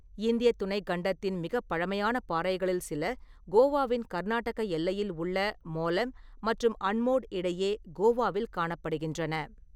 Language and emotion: Tamil, neutral